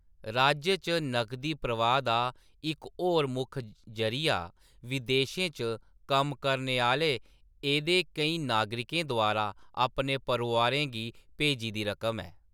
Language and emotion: Dogri, neutral